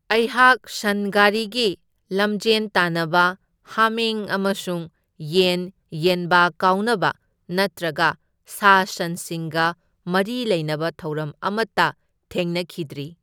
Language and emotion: Manipuri, neutral